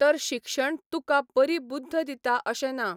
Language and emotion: Goan Konkani, neutral